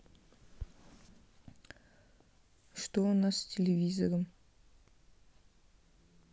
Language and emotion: Russian, neutral